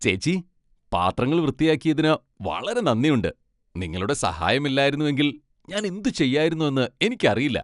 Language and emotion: Malayalam, happy